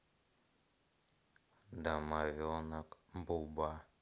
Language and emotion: Russian, neutral